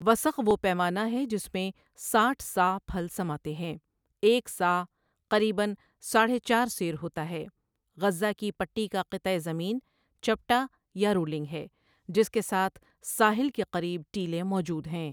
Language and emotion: Urdu, neutral